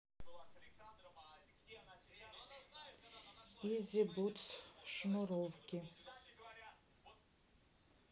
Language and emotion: Russian, neutral